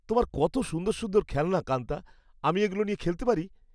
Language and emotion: Bengali, happy